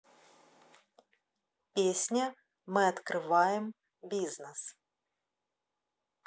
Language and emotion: Russian, neutral